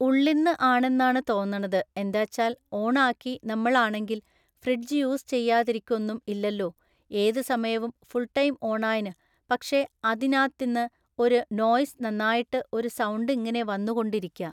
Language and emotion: Malayalam, neutral